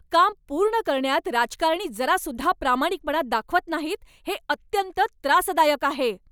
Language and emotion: Marathi, angry